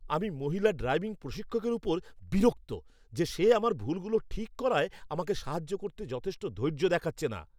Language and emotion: Bengali, angry